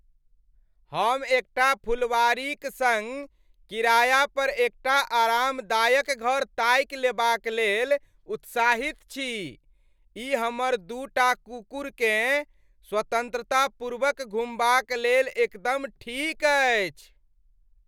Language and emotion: Maithili, happy